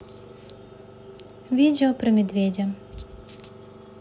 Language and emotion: Russian, neutral